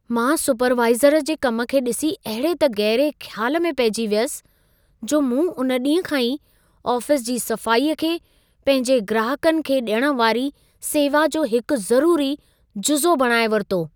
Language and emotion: Sindhi, surprised